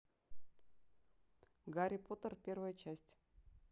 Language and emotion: Russian, neutral